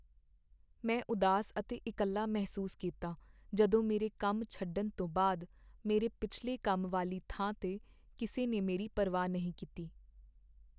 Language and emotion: Punjabi, sad